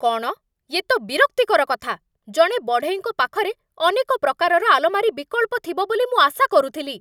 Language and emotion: Odia, angry